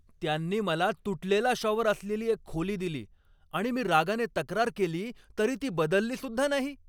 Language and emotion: Marathi, angry